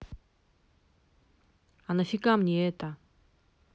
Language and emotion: Russian, angry